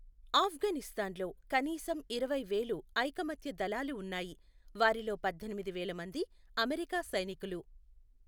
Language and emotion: Telugu, neutral